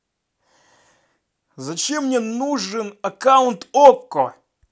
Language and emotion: Russian, angry